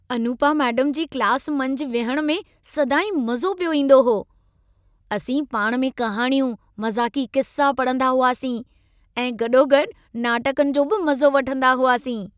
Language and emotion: Sindhi, happy